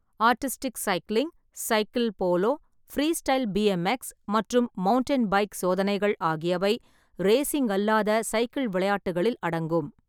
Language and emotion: Tamil, neutral